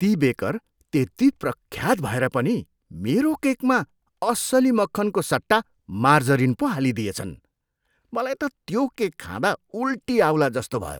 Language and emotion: Nepali, disgusted